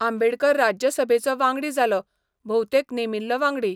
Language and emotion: Goan Konkani, neutral